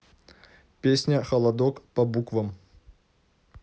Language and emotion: Russian, neutral